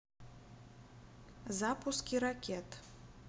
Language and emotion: Russian, neutral